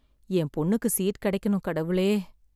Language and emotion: Tamil, sad